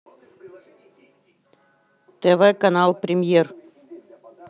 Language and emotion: Russian, neutral